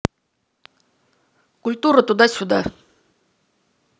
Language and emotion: Russian, angry